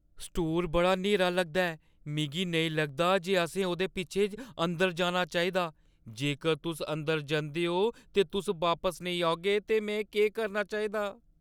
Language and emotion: Dogri, fearful